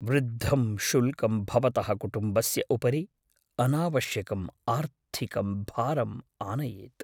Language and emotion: Sanskrit, fearful